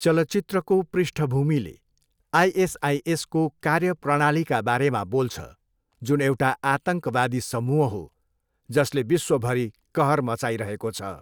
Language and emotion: Nepali, neutral